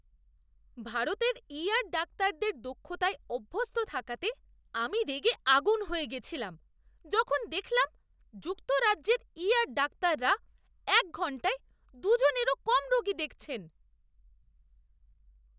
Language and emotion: Bengali, disgusted